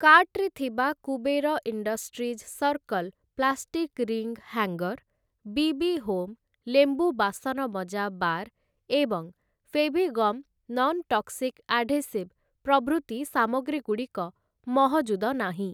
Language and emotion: Odia, neutral